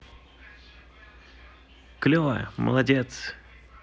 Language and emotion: Russian, positive